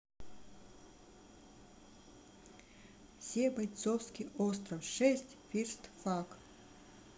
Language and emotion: Russian, neutral